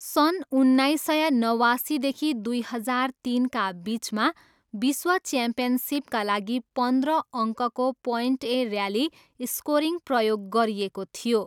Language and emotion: Nepali, neutral